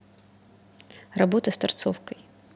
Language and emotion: Russian, neutral